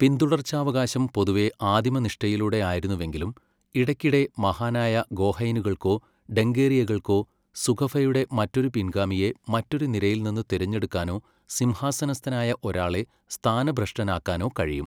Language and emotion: Malayalam, neutral